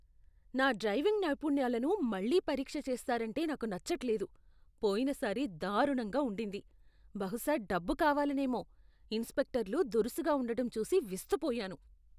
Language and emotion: Telugu, disgusted